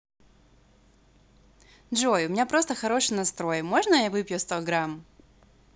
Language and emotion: Russian, positive